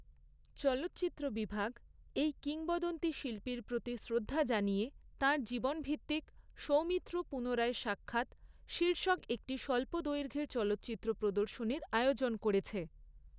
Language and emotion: Bengali, neutral